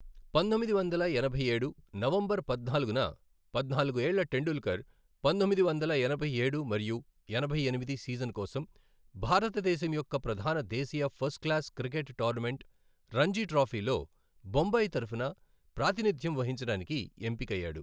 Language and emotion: Telugu, neutral